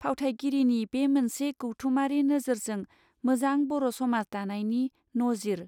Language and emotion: Bodo, neutral